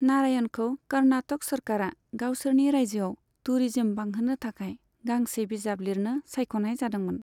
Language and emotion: Bodo, neutral